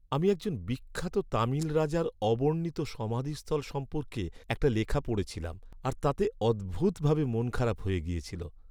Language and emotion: Bengali, sad